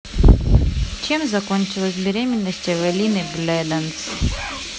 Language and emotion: Russian, neutral